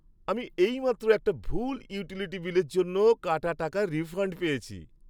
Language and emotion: Bengali, happy